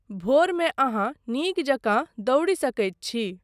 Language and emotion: Maithili, neutral